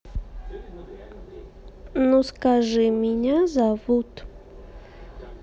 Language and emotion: Russian, neutral